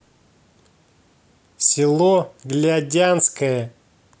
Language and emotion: Russian, angry